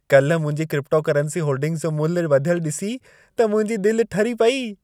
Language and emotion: Sindhi, happy